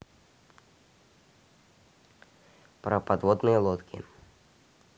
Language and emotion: Russian, neutral